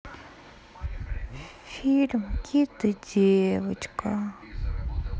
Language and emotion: Russian, sad